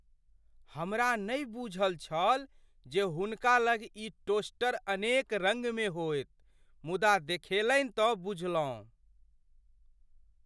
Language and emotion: Maithili, surprised